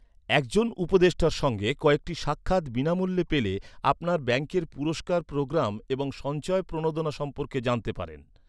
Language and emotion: Bengali, neutral